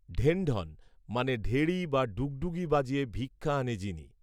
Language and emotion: Bengali, neutral